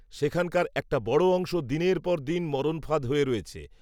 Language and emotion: Bengali, neutral